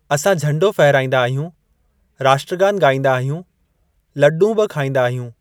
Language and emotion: Sindhi, neutral